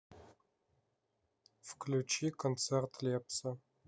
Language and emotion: Russian, neutral